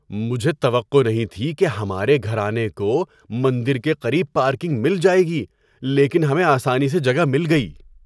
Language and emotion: Urdu, surprised